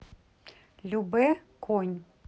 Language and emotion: Russian, neutral